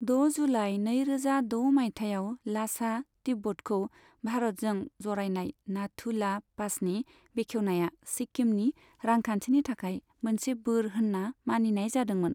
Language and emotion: Bodo, neutral